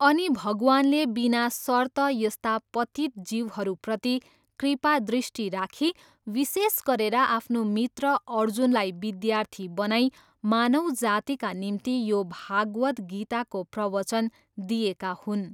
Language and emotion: Nepali, neutral